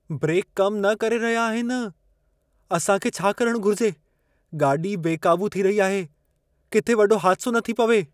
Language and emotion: Sindhi, fearful